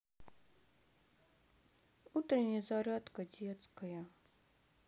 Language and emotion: Russian, sad